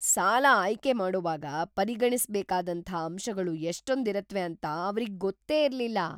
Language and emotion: Kannada, surprised